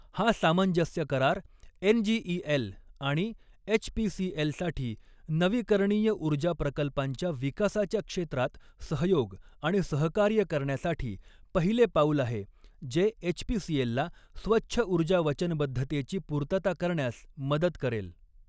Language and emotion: Marathi, neutral